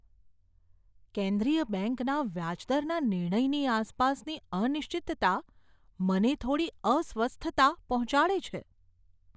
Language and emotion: Gujarati, fearful